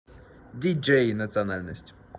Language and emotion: Russian, neutral